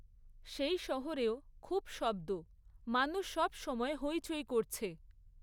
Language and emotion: Bengali, neutral